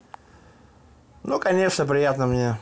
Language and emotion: Russian, neutral